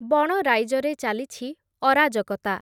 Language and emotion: Odia, neutral